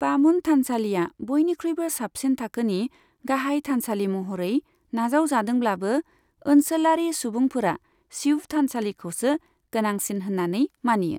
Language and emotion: Bodo, neutral